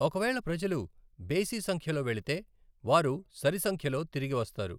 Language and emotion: Telugu, neutral